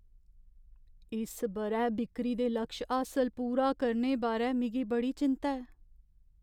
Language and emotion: Dogri, fearful